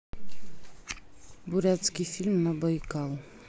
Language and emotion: Russian, neutral